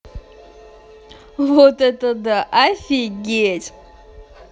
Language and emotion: Russian, positive